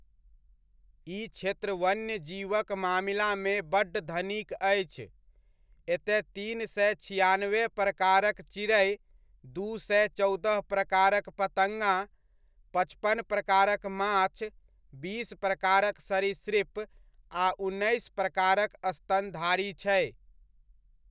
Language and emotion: Maithili, neutral